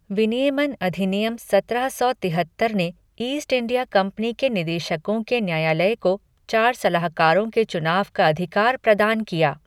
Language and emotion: Hindi, neutral